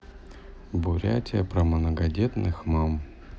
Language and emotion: Russian, neutral